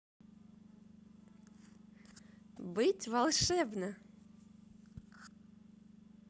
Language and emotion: Russian, positive